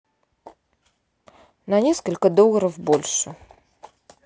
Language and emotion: Russian, neutral